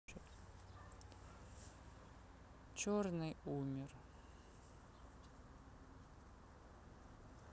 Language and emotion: Russian, sad